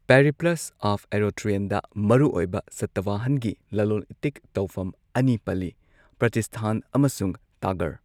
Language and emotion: Manipuri, neutral